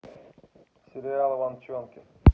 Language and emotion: Russian, neutral